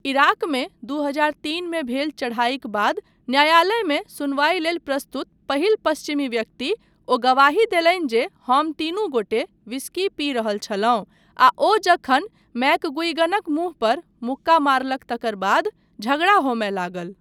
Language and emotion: Maithili, neutral